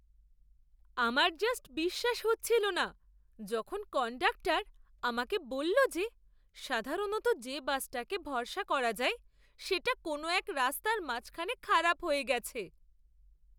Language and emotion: Bengali, surprised